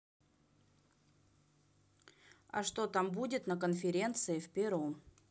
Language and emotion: Russian, neutral